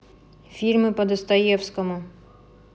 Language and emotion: Russian, neutral